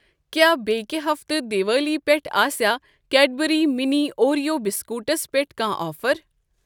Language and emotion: Kashmiri, neutral